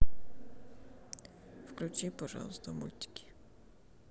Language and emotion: Russian, sad